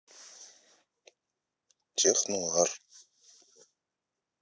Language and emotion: Russian, neutral